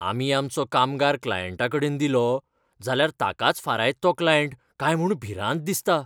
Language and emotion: Goan Konkani, fearful